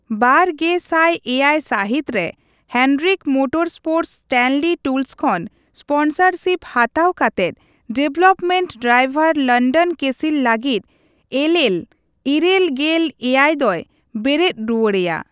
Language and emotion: Santali, neutral